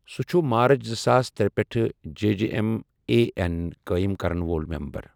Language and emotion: Kashmiri, neutral